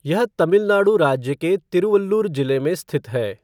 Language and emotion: Hindi, neutral